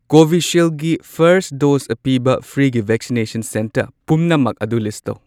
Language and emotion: Manipuri, neutral